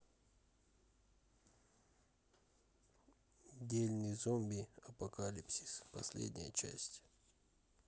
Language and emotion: Russian, neutral